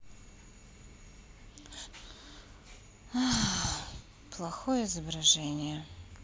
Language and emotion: Russian, sad